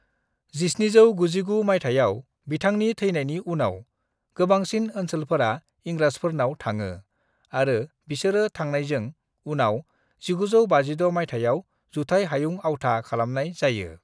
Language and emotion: Bodo, neutral